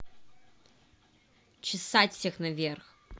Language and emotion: Russian, angry